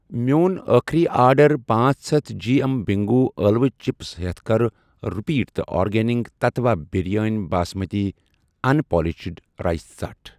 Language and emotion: Kashmiri, neutral